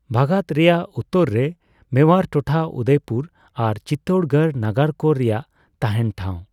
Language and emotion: Santali, neutral